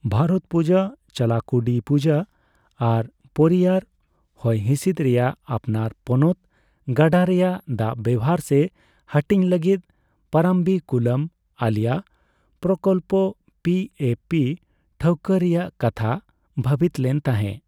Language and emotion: Santali, neutral